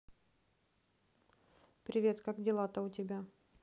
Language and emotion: Russian, neutral